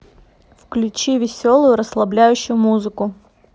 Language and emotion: Russian, neutral